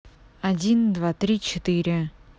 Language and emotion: Russian, neutral